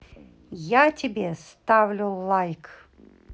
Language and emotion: Russian, neutral